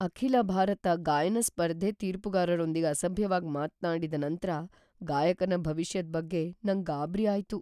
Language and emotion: Kannada, fearful